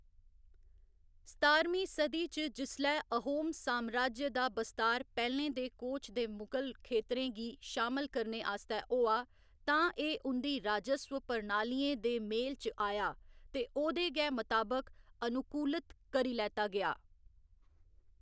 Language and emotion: Dogri, neutral